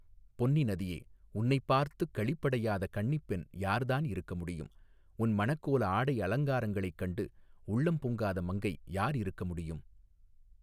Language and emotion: Tamil, neutral